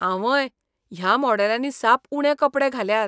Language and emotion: Goan Konkani, disgusted